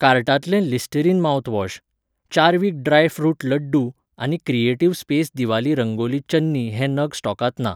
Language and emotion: Goan Konkani, neutral